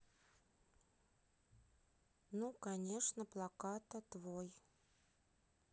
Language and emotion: Russian, neutral